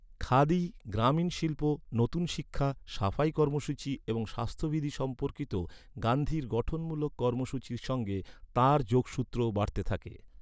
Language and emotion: Bengali, neutral